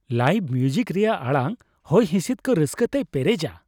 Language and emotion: Santali, happy